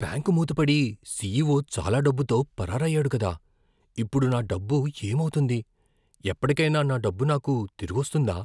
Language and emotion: Telugu, fearful